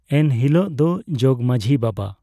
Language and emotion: Santali, neutral